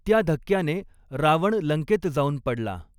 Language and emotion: Marathi, neutral